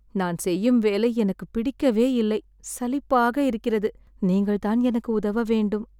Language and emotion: Tamil, sad